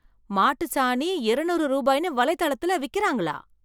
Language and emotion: Tamil, surprised